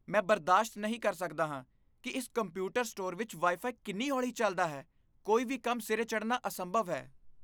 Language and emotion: Punjabi, disgusted